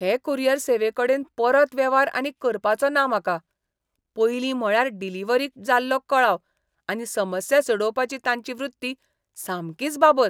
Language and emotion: Goan Konkani, disgusted